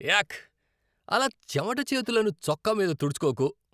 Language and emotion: Telugu, disgusted